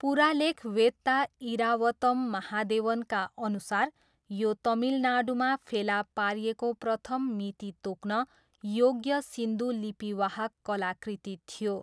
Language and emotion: Nepali, neutral